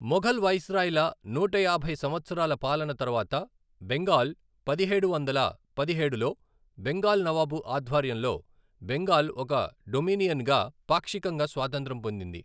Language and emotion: Telugu, neutral